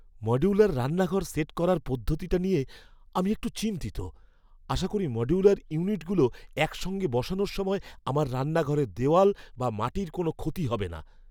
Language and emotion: Bengali, fearful